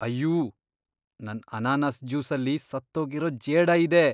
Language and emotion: Kannada, disgusted